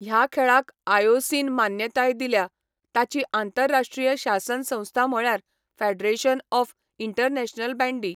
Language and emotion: Goan Konkani, neutral